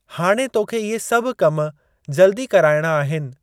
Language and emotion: Sindhi, neutral